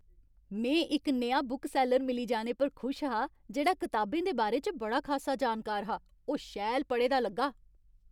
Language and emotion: Dogri, happy